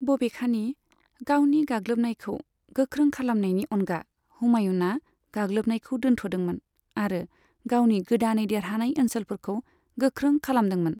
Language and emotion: Bodo, neutral